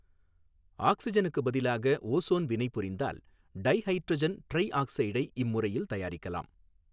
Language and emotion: Tamil, neutral